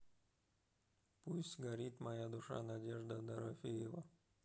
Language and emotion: Russian, neutral